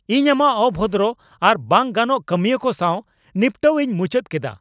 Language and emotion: Santali, angry